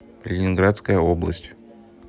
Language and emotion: Russian, neutral